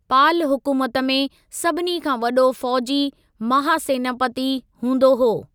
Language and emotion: Sindhi, neutral